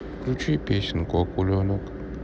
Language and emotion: Russian, sad